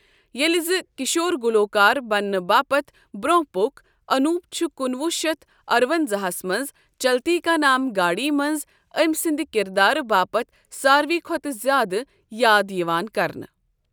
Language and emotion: Kashmiri, neutral